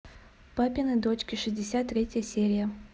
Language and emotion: Russian, neutral